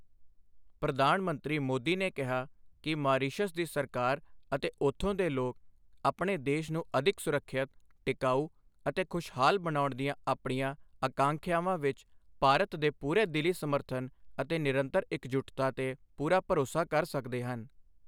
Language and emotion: Punjabi, neutral